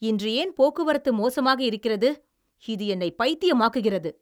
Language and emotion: Tamil, angry